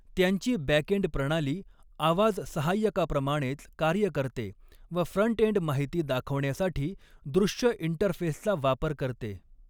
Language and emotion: Marathi, neutral